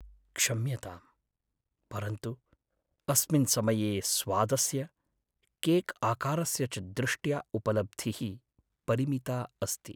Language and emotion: Sanskrit, sad